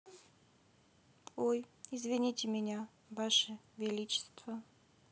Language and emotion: Russian, neutral